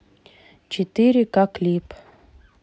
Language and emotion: Russian, neutral